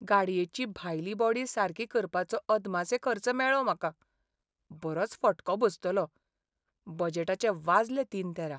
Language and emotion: Goan Konkani, sad